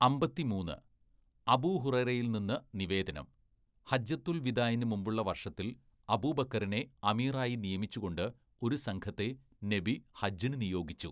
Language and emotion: Malayalam, neutral